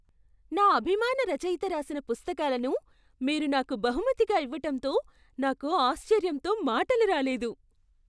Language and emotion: Telugu, surprised